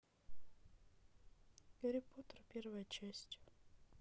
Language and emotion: Russian, neutral